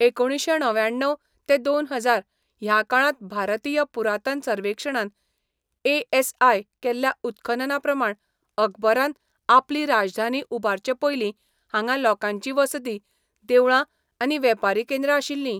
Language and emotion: Goan Konkani, neutral